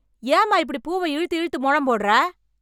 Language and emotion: Tamil, angry